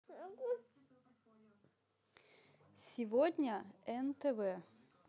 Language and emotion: Russian, positive